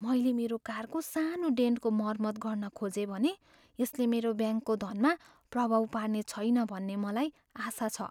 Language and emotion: Nepali, fearful